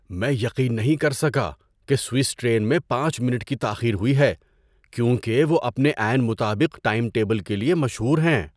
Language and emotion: Urdu, surprised